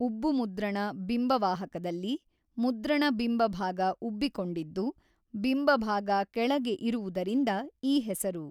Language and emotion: Kannada, neutral